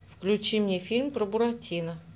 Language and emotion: Russian, neutral